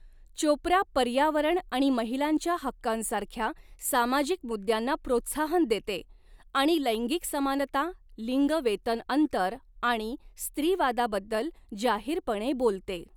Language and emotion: Marathi, neutral